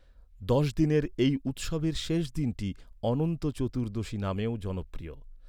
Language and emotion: Bengali, neutral